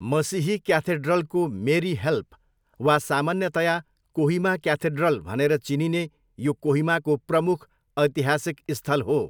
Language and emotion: Nepali, neutral